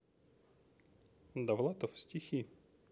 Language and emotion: Russian, neutral